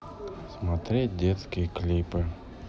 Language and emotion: Russian, sad